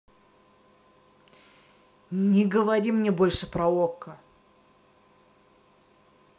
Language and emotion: Russian, angry